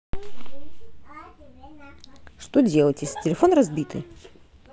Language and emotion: Russian, neutral